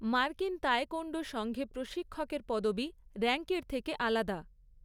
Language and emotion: Bengali, neutral